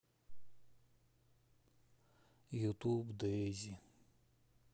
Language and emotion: Russian, sad